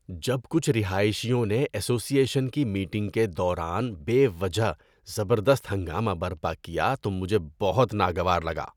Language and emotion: Urdu, disgusted